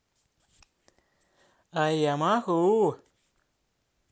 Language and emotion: Russian, positive